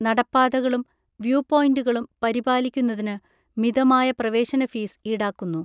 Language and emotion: Malayalam, neutral